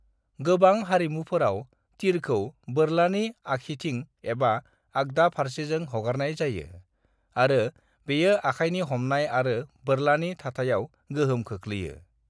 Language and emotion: Bodo, neutral